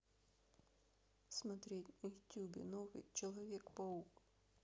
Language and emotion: Russian, neutral